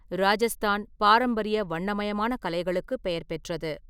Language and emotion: Tamil, neutral